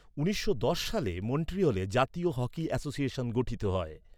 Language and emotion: Bengali, neutral